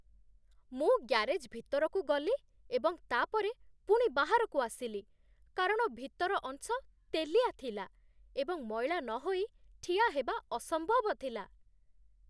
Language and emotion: Odia, disgusted